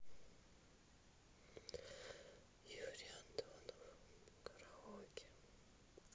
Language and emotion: Russian, sad